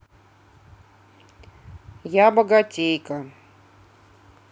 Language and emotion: Russian, neutral